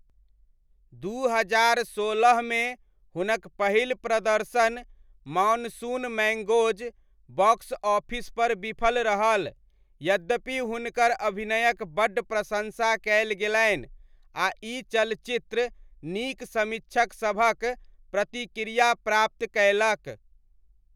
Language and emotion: Maithili, neutral